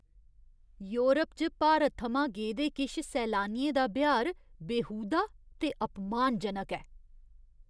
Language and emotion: Dogri, disgusted